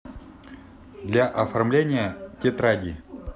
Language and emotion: Russian, neutral